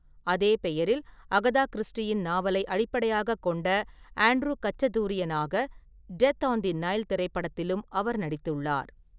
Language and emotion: Tamil, neutral